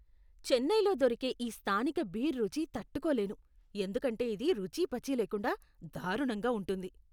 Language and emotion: Telugu, disgusted